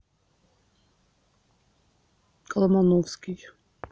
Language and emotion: Russian, neutral